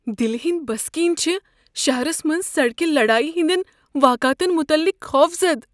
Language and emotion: Kashmiri, fearful